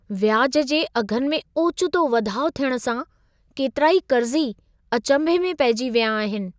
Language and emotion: Sindhi, surprised